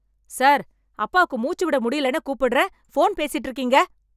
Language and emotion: Tamil, angry